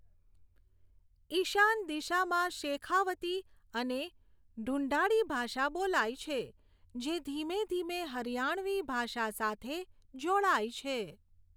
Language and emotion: Gujarati, neutral